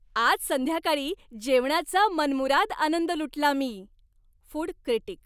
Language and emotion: Marathi, happy